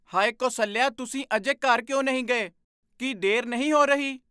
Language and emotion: Punjabi, surprised